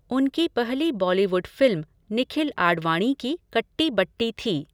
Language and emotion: Hindi, neutral